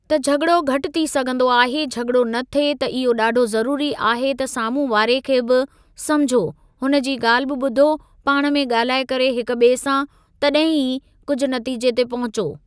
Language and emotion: Sindhi, neutral